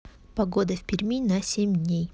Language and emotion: Russian, neutral